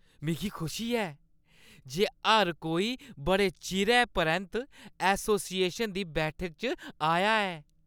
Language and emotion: Dogri, happy